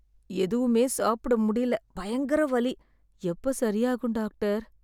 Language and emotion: Tamil, sad